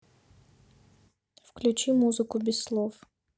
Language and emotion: Russian, neutral